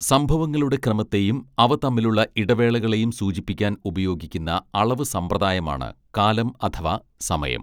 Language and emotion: Malayalam, neutral